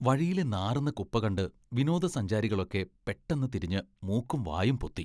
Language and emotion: Malayalam, disgusted